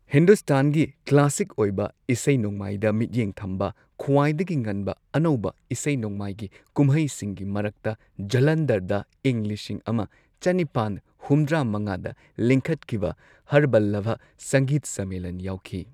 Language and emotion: Manipuri, neutral